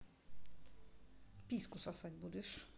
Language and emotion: Russian, neutral